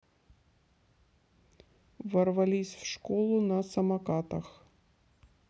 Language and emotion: Russian, neutral